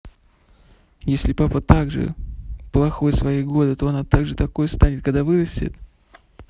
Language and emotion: Russian, neutral